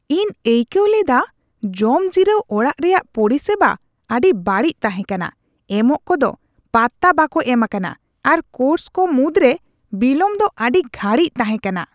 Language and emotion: Santali, disgusted